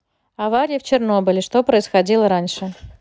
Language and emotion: Russian, neutral